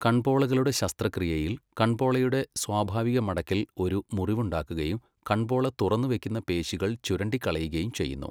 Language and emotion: Malayalam, neutral